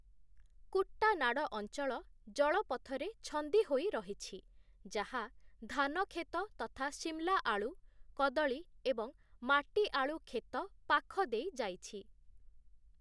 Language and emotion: Odia, neutral